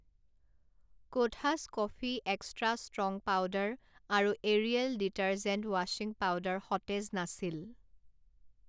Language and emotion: Assamese, neutral